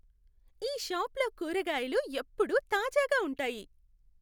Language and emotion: Telugu, happy